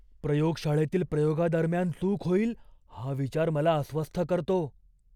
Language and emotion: Marathi, fearful